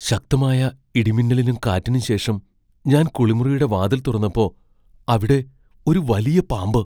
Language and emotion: Malayalam, fearful